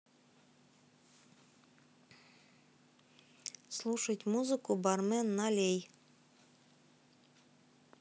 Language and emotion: Russian, neutral